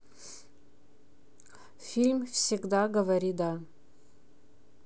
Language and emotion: Russian, neutral